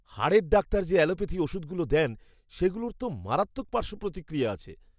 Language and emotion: Bengali, fearful